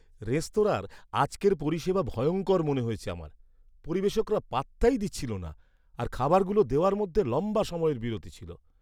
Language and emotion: Bengali, disgusted